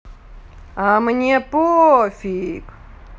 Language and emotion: Russian, angry